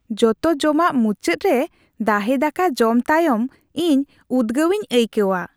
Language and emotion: Santali, happy